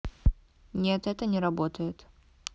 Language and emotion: Russian, neutral